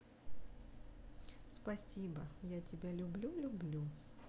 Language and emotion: Russian, neutral